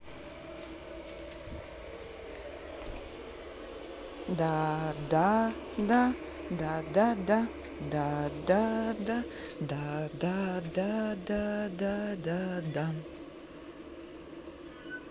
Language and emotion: Russian, positive